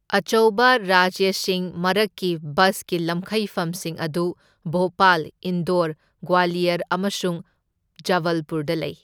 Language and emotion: Manipuri, neutral